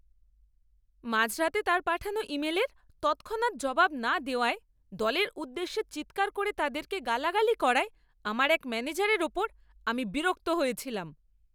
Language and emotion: Bengali, angry